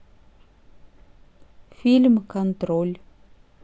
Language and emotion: Russian, neutral